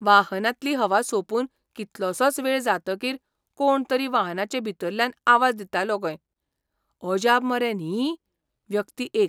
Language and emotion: Goan Konkani, surprised